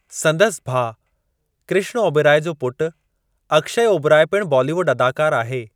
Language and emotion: Sindhi, neutral